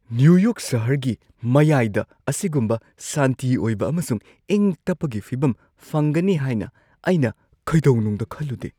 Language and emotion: Manipuri, surprised